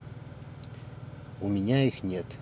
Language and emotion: Russian, neutral